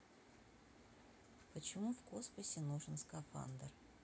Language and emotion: Russian, neutral